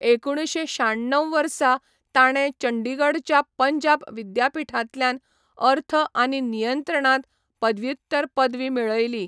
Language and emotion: Goan Konkani, neutral